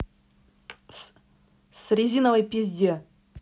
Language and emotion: Russian, angry